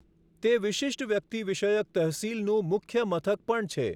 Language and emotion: Gujarati, neutral